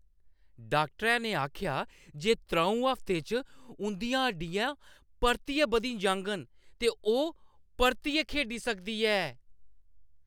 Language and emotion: Dogri, happy